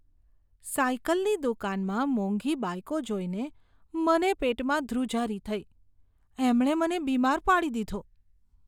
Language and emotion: Gujarati, disgusted